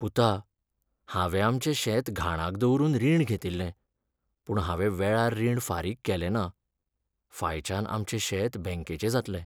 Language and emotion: Goan Konkani, sad